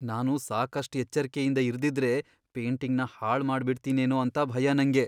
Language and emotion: Kannada, fearful